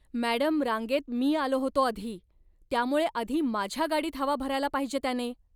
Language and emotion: Marathi, angry